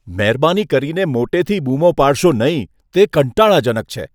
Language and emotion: Gujarati, disgusted